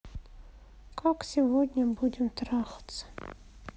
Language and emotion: Russian, sad